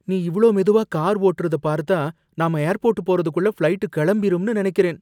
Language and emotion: Tamil, fearful